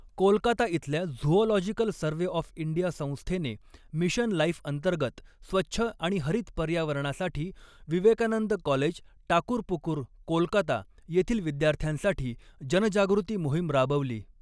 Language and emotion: Marathi, neutral